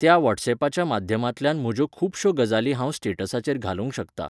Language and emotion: Goan Konkani, neutral